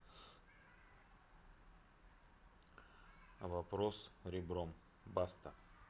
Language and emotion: Russian, neutral